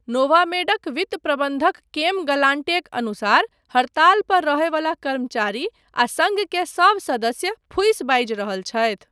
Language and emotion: Maithili, neutral